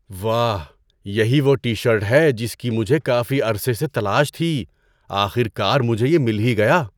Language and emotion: Urdu, surprised